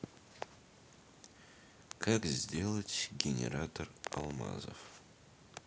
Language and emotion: Russian, neutral